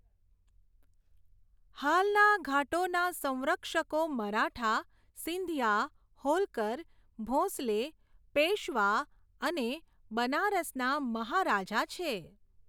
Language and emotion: Gujarati, neutral